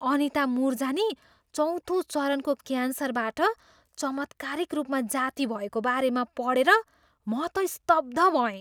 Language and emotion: Nepali, surprised